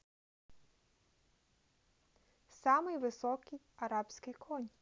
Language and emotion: Russian, neutral